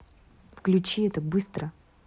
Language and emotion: Russian, angry